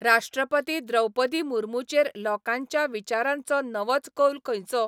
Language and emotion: Goan Konkani, neutral